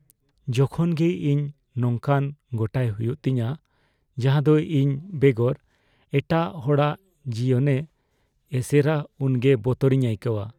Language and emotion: Santali, fearful